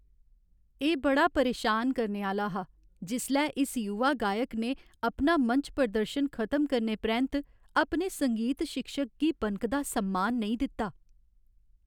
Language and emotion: Dogri, sad